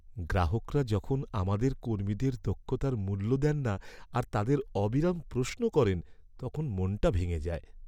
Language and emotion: Bengali, sad